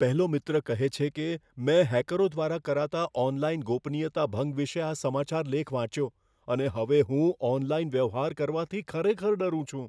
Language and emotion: Gujarati, fearful